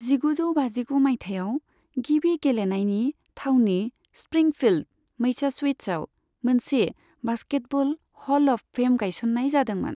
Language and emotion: Bodo, neutral